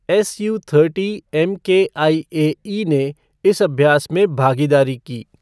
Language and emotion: Hindi, neutral